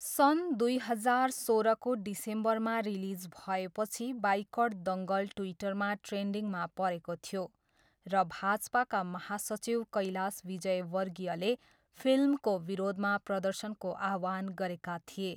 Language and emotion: Nepali, neutral